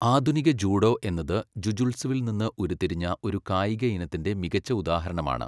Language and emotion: Malayalam, neutral